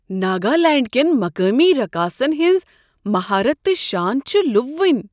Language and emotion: Kashmiri, surprised